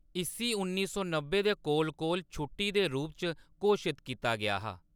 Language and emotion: Dogri, neutral